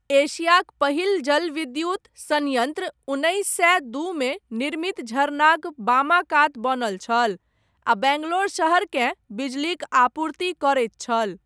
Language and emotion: Maithili, neutral